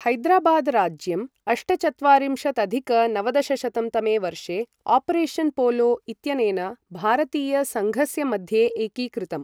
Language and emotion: Sanskrit, neutral